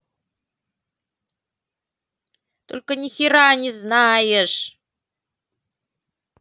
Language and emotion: Russian, angry